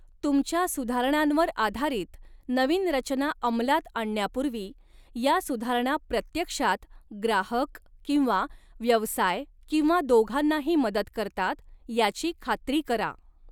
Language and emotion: Marathi, neutral